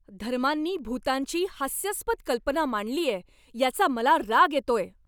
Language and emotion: Marathi, angry